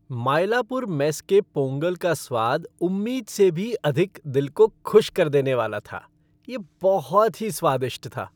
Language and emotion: Hindi, happy